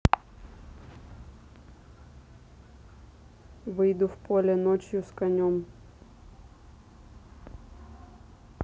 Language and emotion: Russian, neutral